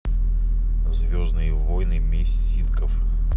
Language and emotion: Russian, neutral